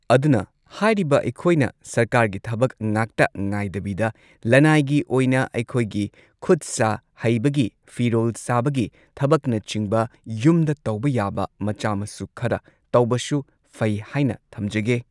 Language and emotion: Manipuri, neutral